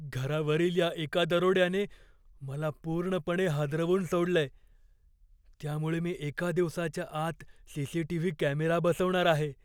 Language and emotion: Marathi, fearful